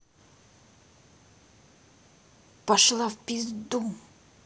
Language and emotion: Russian, angry